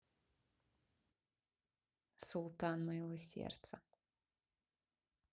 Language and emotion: Russian, positive